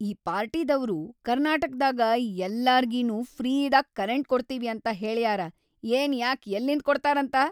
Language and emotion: Kannada, angry